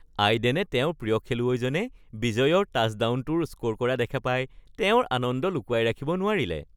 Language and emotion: Assamese, happy